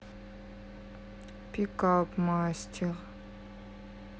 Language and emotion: Russian, sad